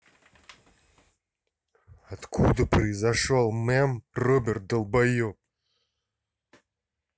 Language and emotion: Russian, angry